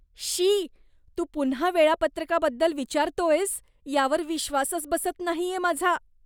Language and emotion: Marathi, disgusted